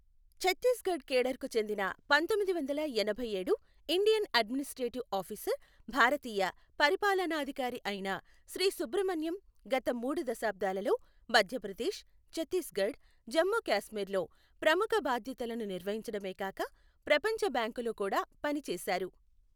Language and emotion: Telugu, neutral